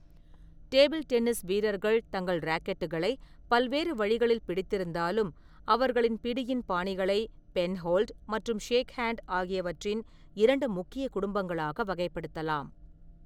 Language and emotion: Tamil, neutral